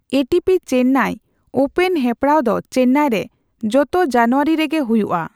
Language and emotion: Santali, neutral